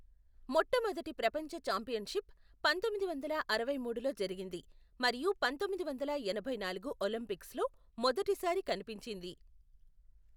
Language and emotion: Telugu, neutral